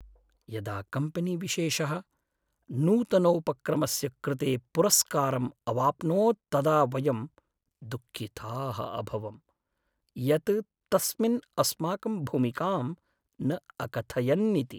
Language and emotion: Sanskrit, sad